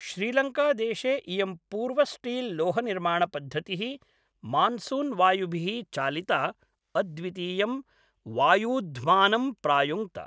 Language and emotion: Sanskrit, neutral